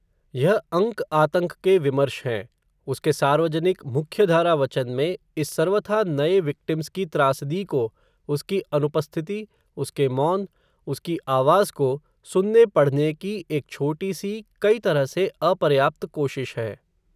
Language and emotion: Hindi, neutral